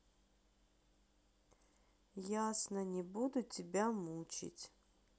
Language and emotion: Russian, sad